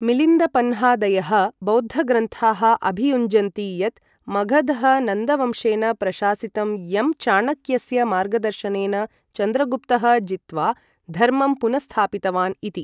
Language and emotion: Sanskrit, neutral